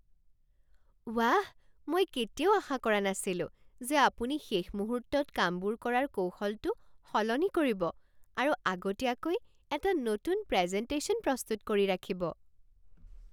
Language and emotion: Assamese, surprised